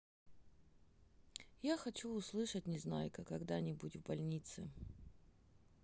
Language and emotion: Russian, sad